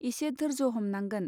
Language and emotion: Bodo, neutral